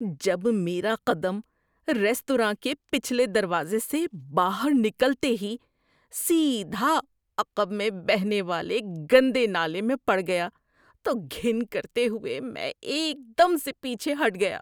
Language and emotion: Urdu, disgusted